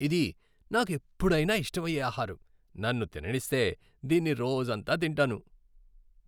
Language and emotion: Telugu, happy